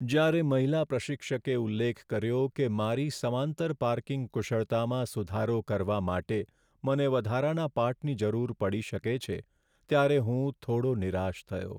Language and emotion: Gujarati, sad